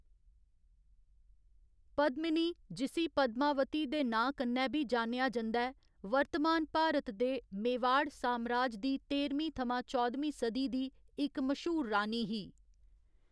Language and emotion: Dogri, neutral